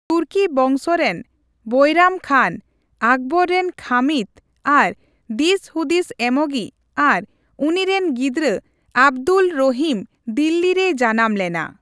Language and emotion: Santali, neutral